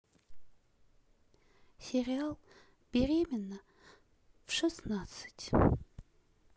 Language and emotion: Russian, sad